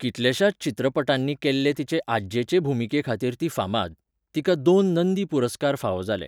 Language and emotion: Goan Konkani, neutral